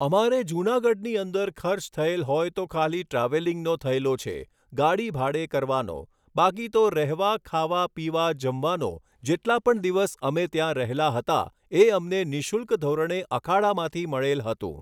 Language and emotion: Gujarati, neutral